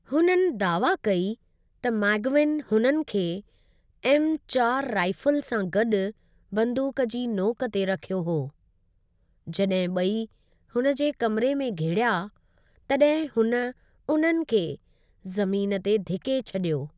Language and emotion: Sindhi, neutral